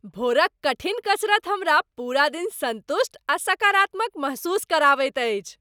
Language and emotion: Maithili, happy